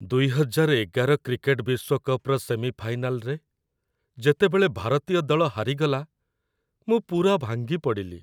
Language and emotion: Odia, sad